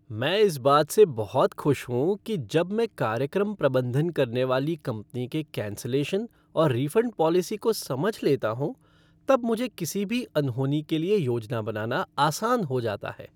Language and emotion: Hindi, happy